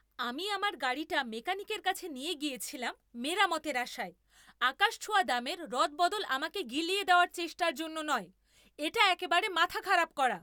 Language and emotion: Bengali, angry